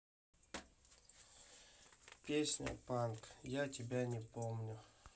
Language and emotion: Russian, sad